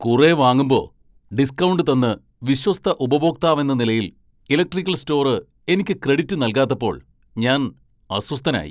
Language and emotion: Malayalam, angry